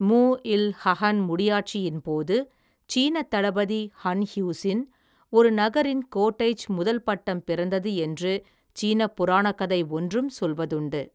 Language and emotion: Tamil, neutral